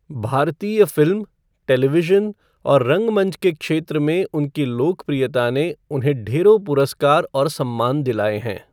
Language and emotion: Hindi, neutral